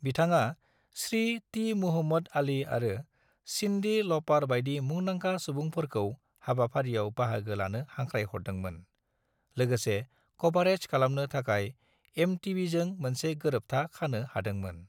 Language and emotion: Bodo, neutral